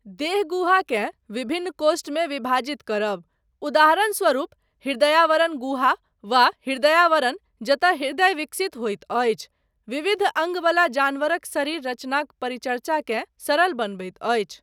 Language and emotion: Maithili, neutral